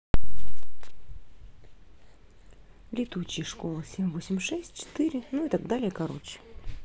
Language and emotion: Russian, neutral